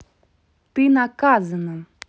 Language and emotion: Russian, angry